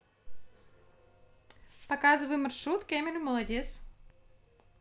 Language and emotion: Russian, neutral